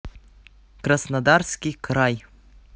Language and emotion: Russian, neutral